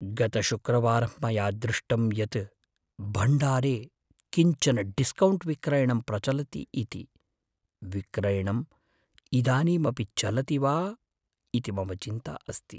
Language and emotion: Sanskrit, fearful